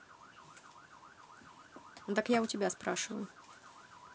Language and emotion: Russian, angry